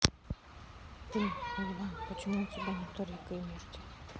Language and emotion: Russian, neutral